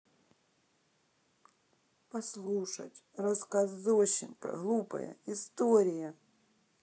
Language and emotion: Russian, sad